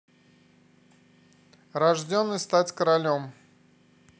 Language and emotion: Russian, neutral